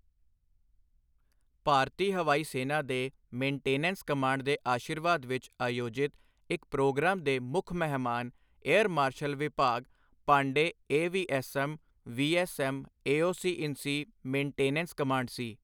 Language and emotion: Punjabi, neutral